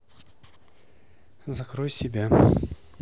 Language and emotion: Russian, neutral